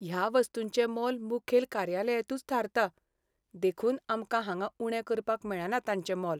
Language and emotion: Goan Konkani, sad